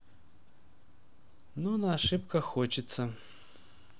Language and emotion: Russian, sad